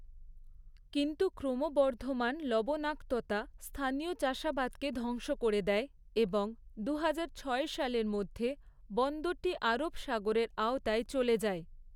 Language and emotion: Bengali, neutral